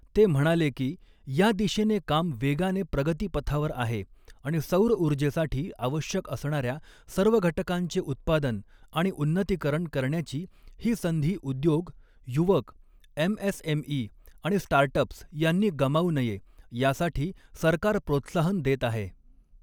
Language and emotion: Marathi, neutral